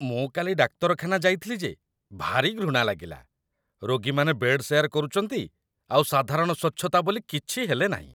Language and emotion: Odia, disgusted